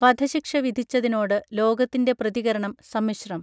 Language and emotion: Malayalam, neutral